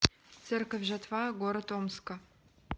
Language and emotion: Russian, neutral